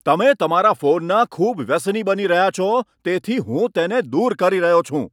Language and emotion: Gujarati, angry